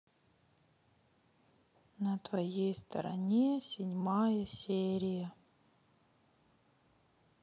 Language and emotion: Russian, sad